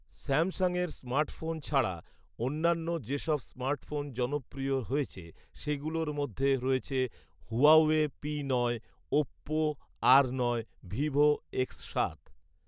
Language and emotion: Bengali, neutral